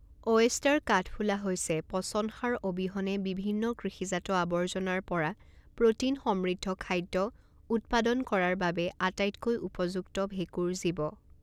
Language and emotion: Assamese, neutral